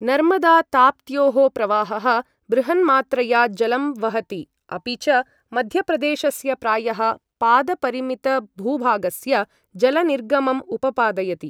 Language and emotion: Sanskrit, neutral